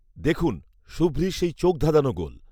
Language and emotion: Bengali, neutral